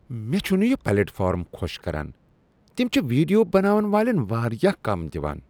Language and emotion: Kashmiri, disgusted